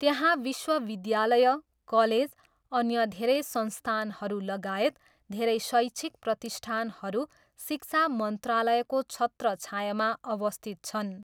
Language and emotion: Nepali, neutral